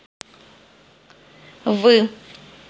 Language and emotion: Russian, neutral